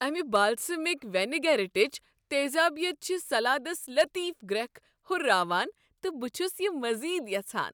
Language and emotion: Kashmiri, happy